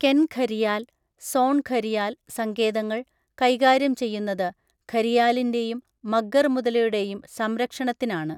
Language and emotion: Malayalam, neutral